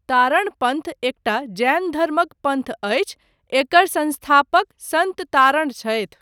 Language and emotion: Maithili, neutral